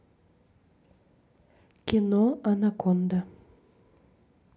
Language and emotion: Russian, neutral